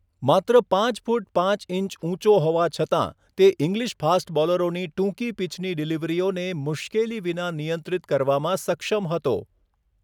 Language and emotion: Gujarati, neutral